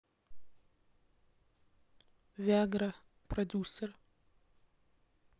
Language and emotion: Russian, neutral